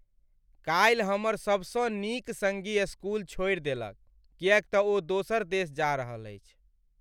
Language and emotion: Maithili, sad